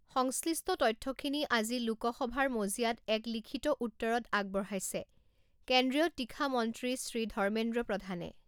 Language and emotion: Assamese, neutral